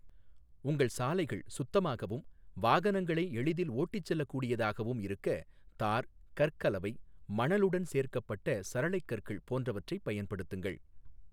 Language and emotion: Tamil, neutral